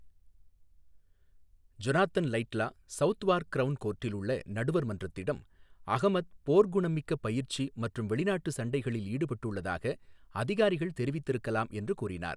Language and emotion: Tamil, neutral